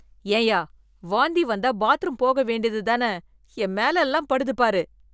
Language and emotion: Tamil, disgusted